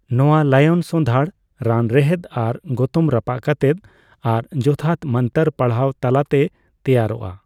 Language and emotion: Santali, neutral